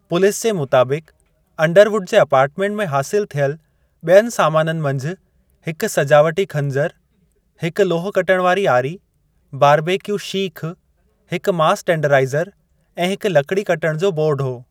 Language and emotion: Sindhi, neutral